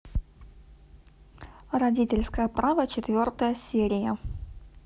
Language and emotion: Russian, neutral